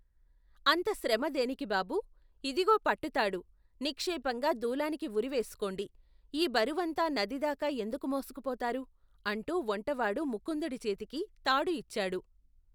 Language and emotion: Telugu, neutral